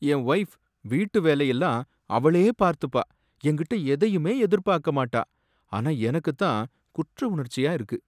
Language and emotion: Tamil, sad